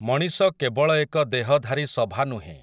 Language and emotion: Odia, neutral